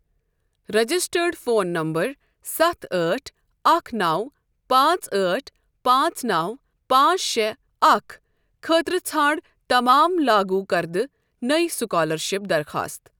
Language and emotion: Kashmiri, neutral